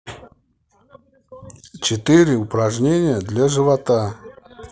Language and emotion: Russian, neutral